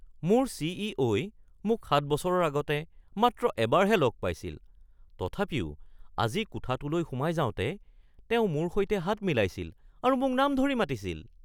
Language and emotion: Assamese, surprised